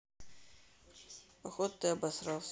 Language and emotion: Russian, neutral